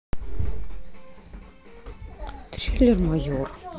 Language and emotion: Russian, neutral